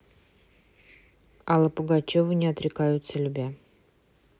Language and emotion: Russian, neutral